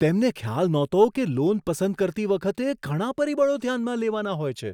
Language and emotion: Gujarati, surprised